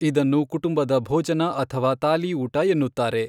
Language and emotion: Kannada, neutral